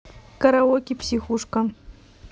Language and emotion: Russian, neutral